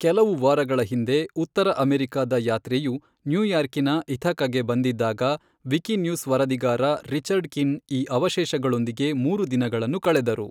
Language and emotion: Kannada, neutral